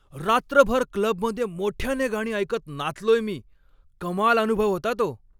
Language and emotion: Marathi, happy